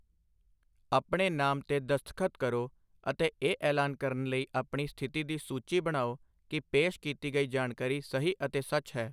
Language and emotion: Punjabi, neutral